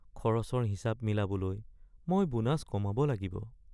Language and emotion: Assamese, sad